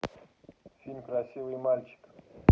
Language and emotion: Russian, neutral